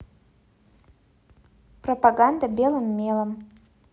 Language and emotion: Russian, neutral